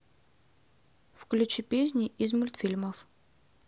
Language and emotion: Russian, neutral